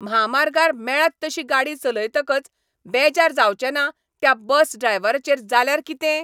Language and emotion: Goan Konkani, angry